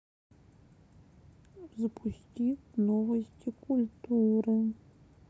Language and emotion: Russian, sad